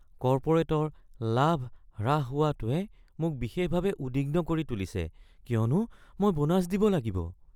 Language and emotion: Assamese, fearful